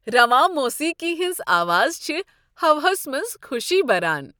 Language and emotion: Kashmiri, happy